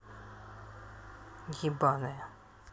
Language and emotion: Russian, angry